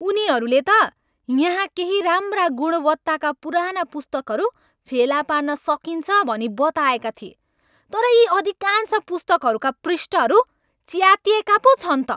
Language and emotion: Nepali, angry